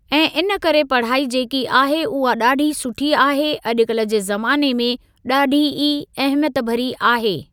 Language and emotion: Sindhi, neutral